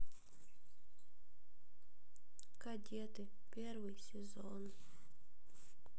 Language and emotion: Russian, sad